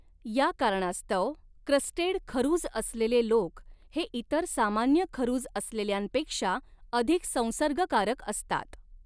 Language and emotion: Marathi, neutral